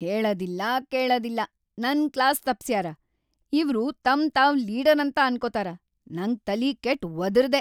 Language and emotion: Kannada, angry